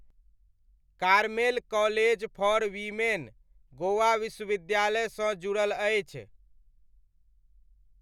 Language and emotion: Maithili, neutral